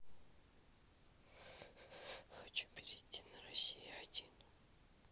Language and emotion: Russian, sad